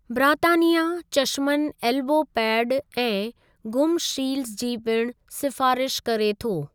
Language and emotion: Sindhi, neutral